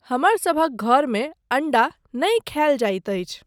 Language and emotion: Maithili, neutral